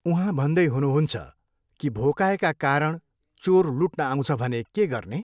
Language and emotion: Nepali, neutral